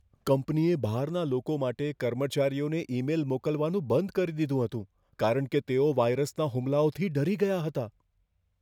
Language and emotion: Gujarati, fearful